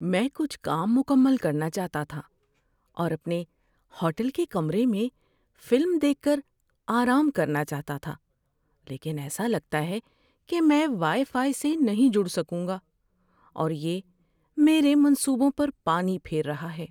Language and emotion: Urdu, sad